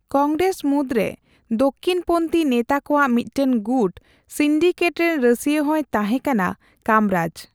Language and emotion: Santali, neutral